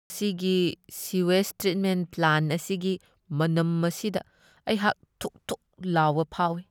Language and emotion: Manipuri, disgusted